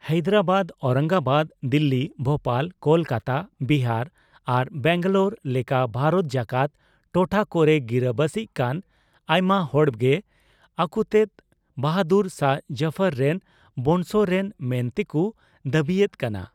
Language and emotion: Santali, neutral